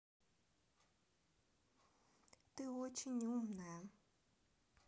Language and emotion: Russian, neutral